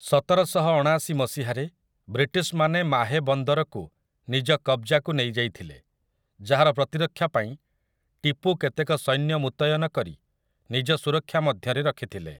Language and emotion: Odia, neutral